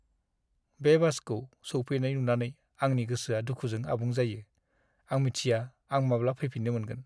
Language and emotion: Bodo, sad